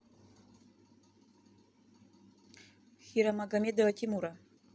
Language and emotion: Russian, neutral